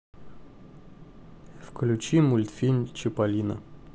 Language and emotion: Russian, neutral